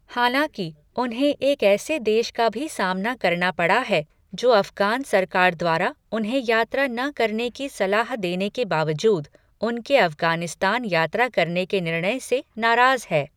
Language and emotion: Hindi, neutral